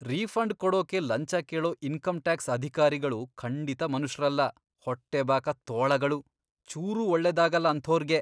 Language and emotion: Kannada, disgusted